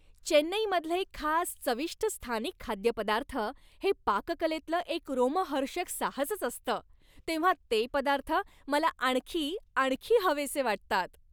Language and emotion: Marathi, happy